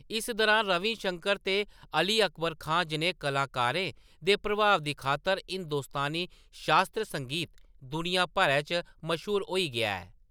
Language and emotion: Dogri, neutral